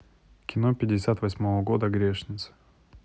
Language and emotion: Russian, neutral